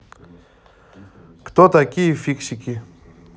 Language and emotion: Russian, neutral